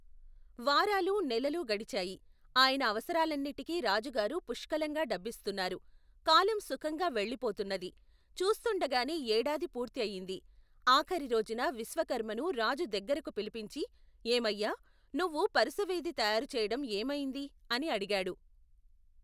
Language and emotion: Telugu, neutral